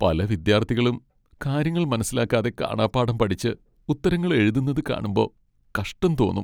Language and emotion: Malayalam, sad